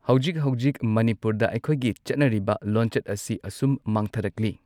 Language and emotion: Manipuri, neutral